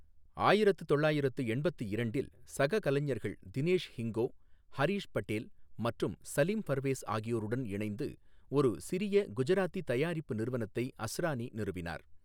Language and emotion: Tamil, neutral